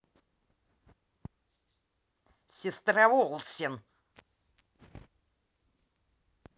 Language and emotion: Russian, angry